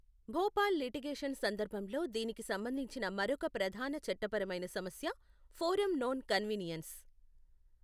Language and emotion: Telugu, neutral